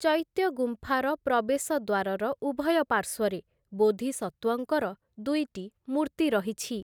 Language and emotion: Odia, neutral